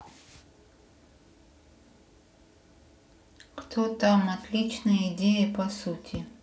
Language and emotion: Russian, sad